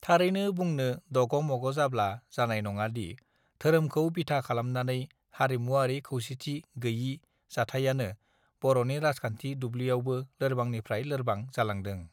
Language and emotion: Bodo, neutral